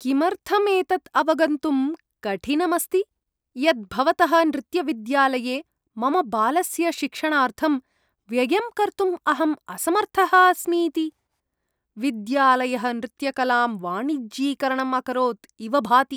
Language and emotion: Sanskrit, disgusted